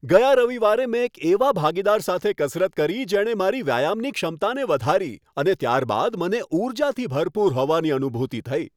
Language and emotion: Gujarati, happy